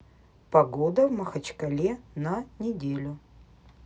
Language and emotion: Russian, neutral